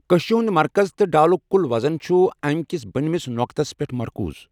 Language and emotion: Kashmiri, neutral